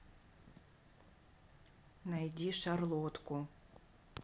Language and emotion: Russian, neutral